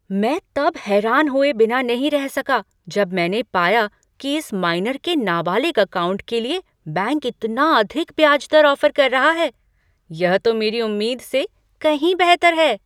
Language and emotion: Hindi, surprised